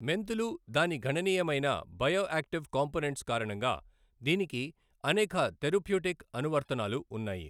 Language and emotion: Telugu, neutral